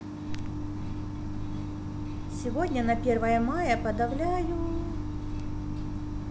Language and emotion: Russian, positive